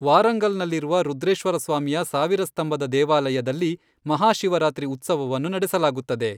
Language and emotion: Kannada, neutral